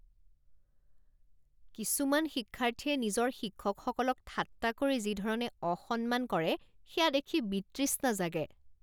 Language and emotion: Assamese, disgusted